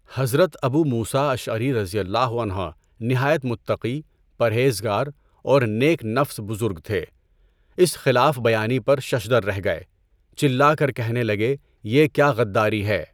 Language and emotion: Urdu, neutral